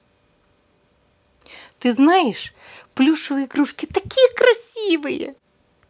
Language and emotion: Russian, positive